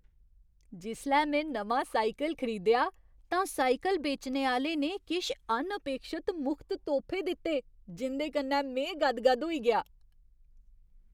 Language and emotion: Dogri, surprised